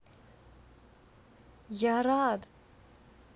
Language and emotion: Russian, positive